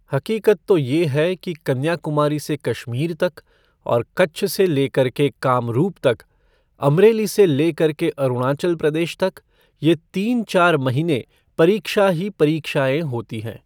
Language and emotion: Hindi, neutral